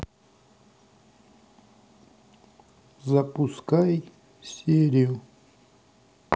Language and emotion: Russian, sad